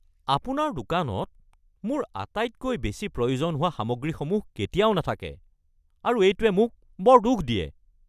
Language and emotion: Assamese, angry